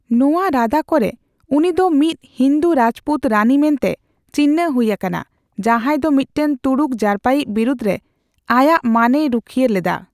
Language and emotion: Santali, neutral